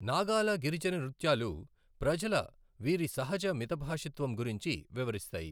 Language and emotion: Telugu, neutral